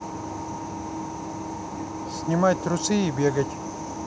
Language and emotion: Russian, neutral